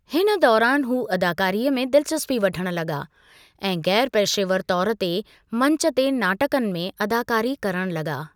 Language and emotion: Sindhi, neutral